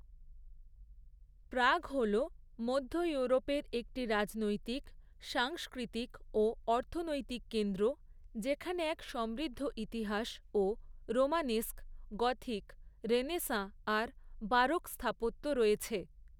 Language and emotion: Bengali, neutral